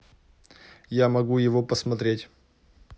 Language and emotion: Russian, neutral